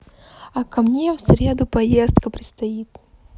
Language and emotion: Russian, positive